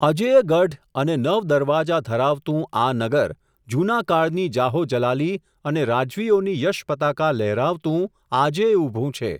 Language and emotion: Gujarati, neutral